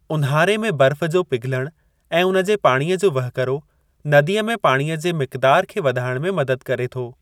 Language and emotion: Sindhi, neutral